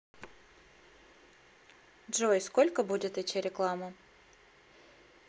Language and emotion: Russian, neutral